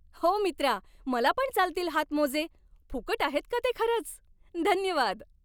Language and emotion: Marathi, happy